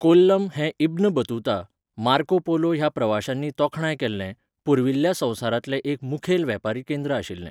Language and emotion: Goan Konkani, neutral